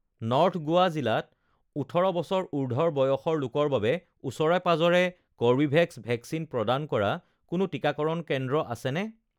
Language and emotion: Assamese, neutral